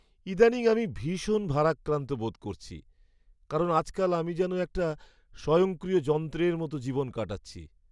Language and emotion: Bengali, sad